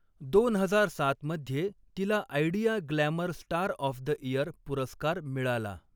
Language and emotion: Marathi, neutral